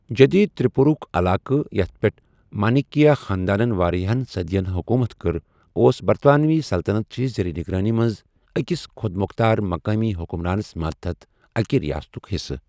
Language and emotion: Kashmiri, neutral